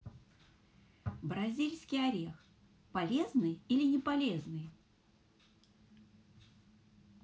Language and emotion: Russian, positive